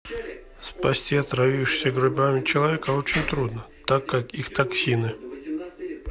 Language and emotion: Russian, neutral